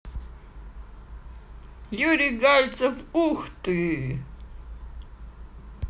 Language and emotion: Russian, positive